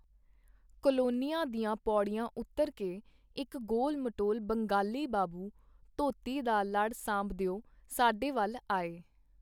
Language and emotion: Punjabi, neutral